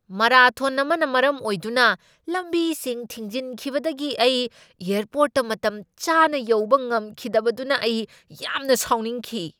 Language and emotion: Manipuri, angry